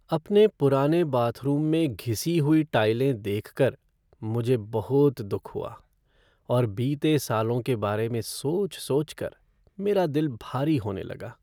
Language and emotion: Hindi, sad